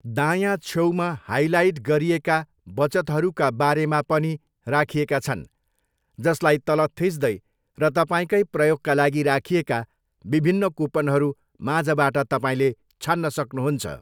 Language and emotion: Nepali, neutral